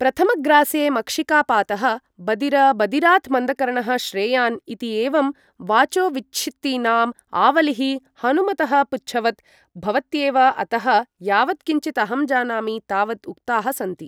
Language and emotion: Sanskrit, neutral